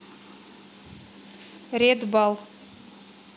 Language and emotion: Russian, neutral